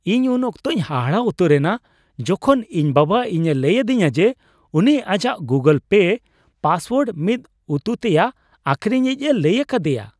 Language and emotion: Santali, surprised